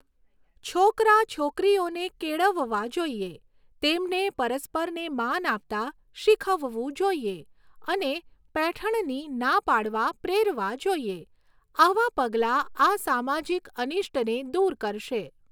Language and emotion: Gujarati, neutral